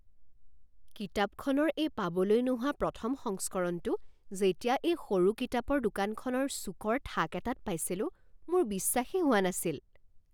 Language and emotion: Assamese, surprised